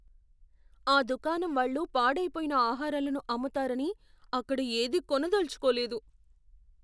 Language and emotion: Telugu, fearful